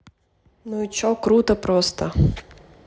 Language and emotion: Russian, neutral